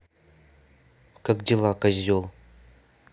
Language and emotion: Russian, angry